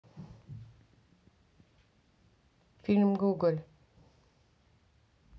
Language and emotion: Russian, neutral